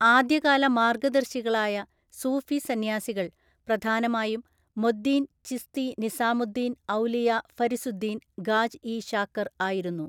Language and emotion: Malayalam, neutral